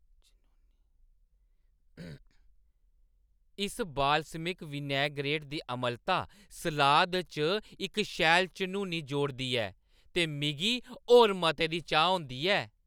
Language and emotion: Dogri, happy